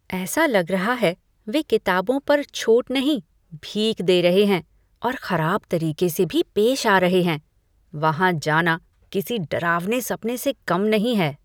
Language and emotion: Hindi, disgusted